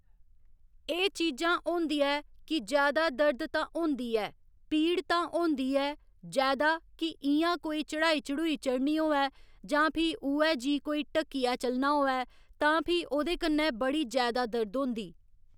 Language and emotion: Dogri, neutral